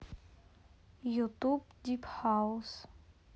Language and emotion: Russian, neutral